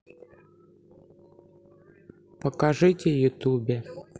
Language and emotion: Russian, neutral